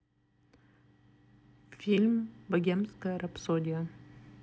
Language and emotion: Russian, neutral